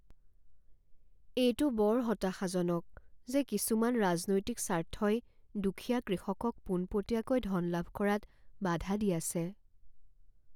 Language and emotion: Assamese, sad